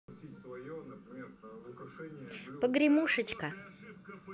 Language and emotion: Russian, positive